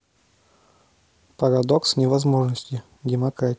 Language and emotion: Russian, neutral